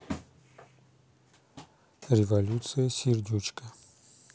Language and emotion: Russian, neutral